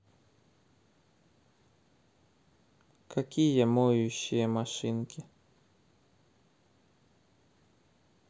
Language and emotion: Russian, neutral